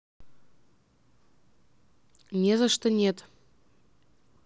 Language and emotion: Russian, neutral